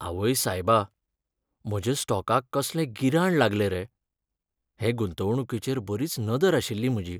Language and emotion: Goan Konkani, sad